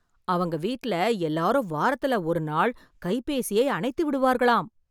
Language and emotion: Tamil, surprised